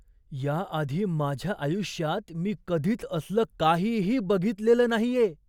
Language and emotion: Marathi, surprised